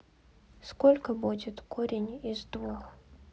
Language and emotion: Russian, neutral